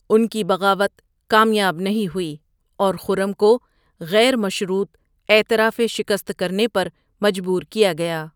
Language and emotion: Urdu, neutral